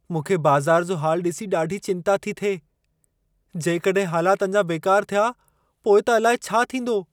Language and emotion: Sindhi, fearful